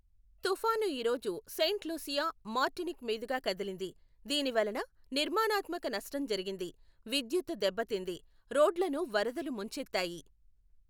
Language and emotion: Telugu, neutral